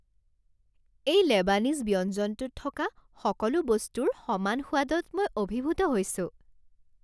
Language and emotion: Assamese, happy